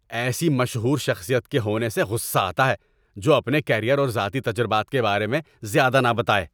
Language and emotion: Urdu, angry